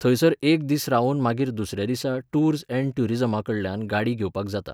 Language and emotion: Goan Konkani, neutral